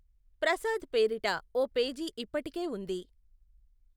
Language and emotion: Telugu, neutral